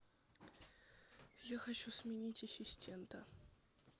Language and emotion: Russian, neutral